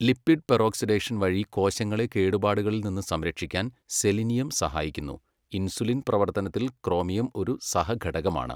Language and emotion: Malayalam, neutral